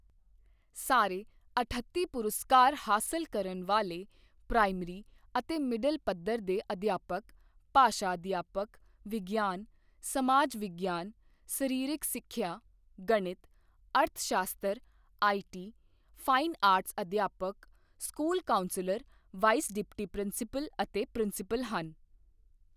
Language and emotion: Punjabi, neutral